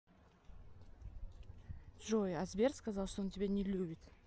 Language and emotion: Russian, neutral